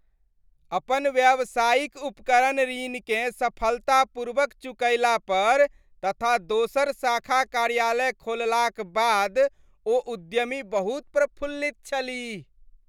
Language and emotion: Maithili, happy